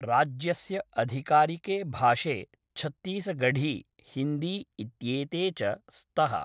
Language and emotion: Sanskrit, neutral